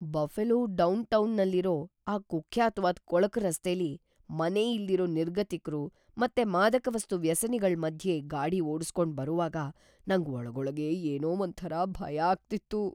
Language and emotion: Kannada, fearful